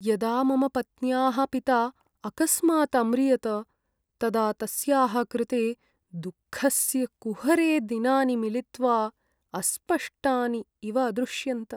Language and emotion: Sanskrit, sad